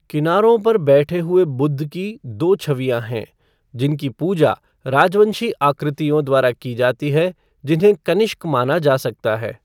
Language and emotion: Hindi, neutral